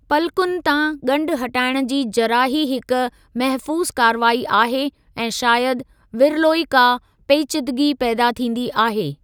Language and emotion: Sindhi, neutral